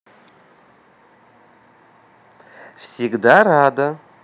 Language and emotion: Russian, positive